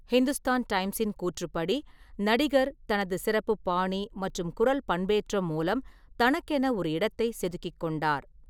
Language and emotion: Tamil, neutral